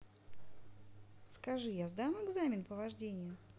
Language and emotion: Russian, positive